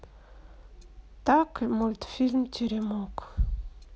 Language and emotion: Russian, sad